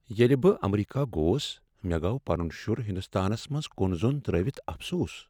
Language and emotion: Kashmiri, sad